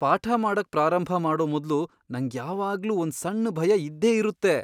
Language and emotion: Kannada, fearful